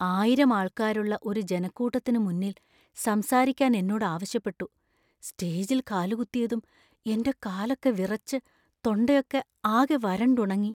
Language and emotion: Malayalam, fearful